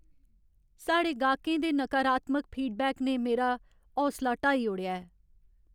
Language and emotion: Dogri, sad